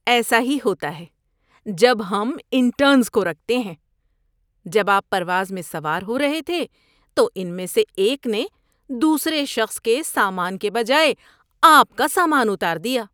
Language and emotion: Urdu, disgusted